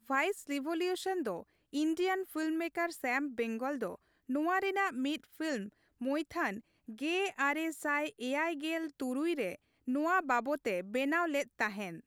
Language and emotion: Santali, neutral